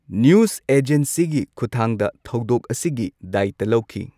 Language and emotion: Manipuri, neutral